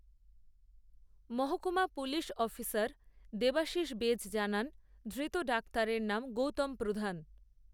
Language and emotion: Bengali, neutral